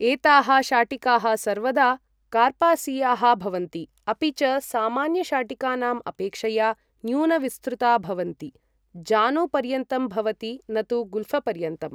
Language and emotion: Sanskrit, neutral